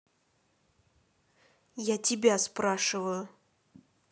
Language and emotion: Russian, angry